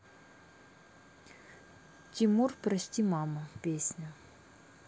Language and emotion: Russian, neutral